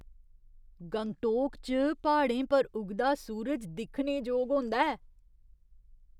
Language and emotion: Dogri, surprised